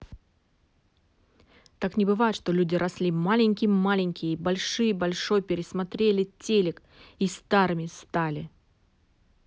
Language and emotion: Russian, angry